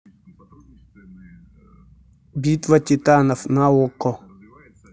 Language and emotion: Russian, neutral